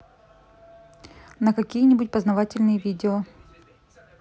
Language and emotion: Russian, neutral